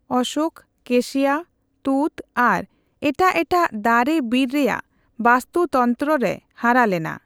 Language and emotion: Santali, neutral